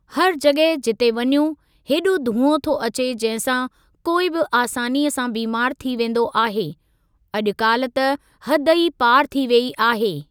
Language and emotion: Sindhi, neutral